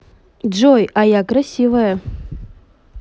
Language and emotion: Russian, neutral